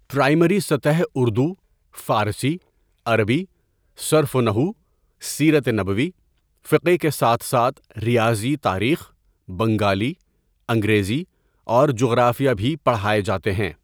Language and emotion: Urdu, neutral